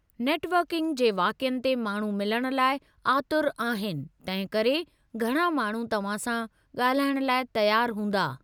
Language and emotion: Sindhi, neutral